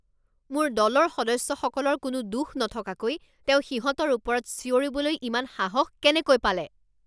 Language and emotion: Assamese, angry